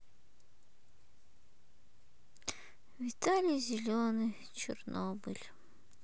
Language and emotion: Russian, sad